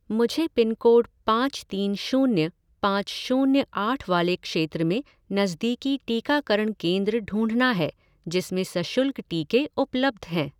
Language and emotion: Hindi, neutral